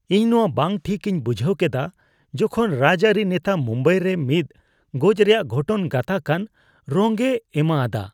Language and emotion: Santali, disgusted